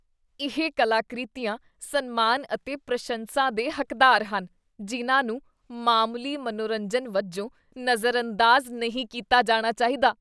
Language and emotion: Punjabi, disgusted